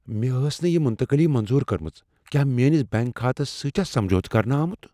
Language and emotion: Kashmiri, fearful